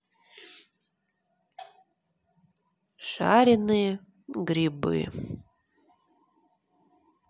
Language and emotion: Russian, neutral